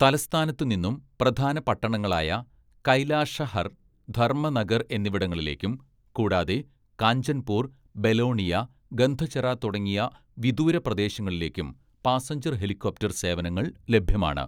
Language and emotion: Malayalam, neutral